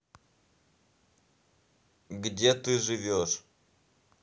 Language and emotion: Russian, neutral